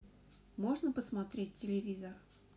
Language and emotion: Russian, neutral